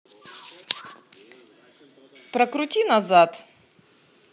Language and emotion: Russian, neutral